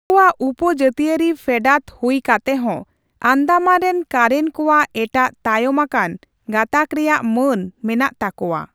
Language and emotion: Santali, neutral